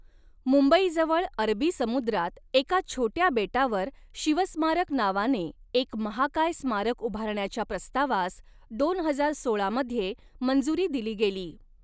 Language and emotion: Marathi, neutral